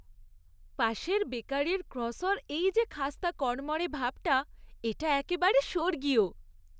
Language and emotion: Bengali, happy